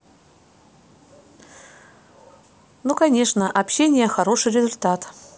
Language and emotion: Russian, neutral